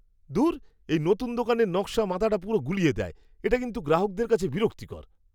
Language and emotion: Bengali, disgusted